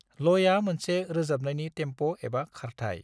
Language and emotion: Bodo, neutral